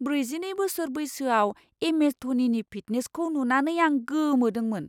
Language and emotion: Bodo, surprised